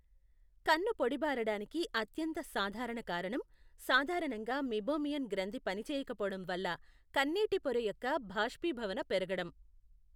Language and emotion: Telugu, neutral